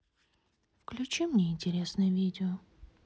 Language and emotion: Russian, sad